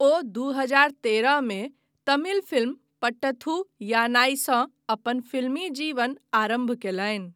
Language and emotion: Maithili, neutral